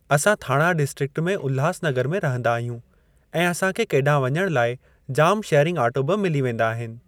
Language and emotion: Sindhi, neutral